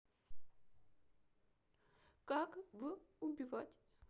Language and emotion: Russian, sad